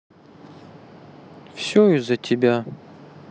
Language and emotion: Russian, sad